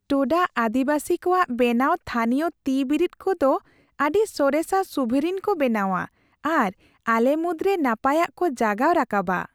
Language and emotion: Santali, happy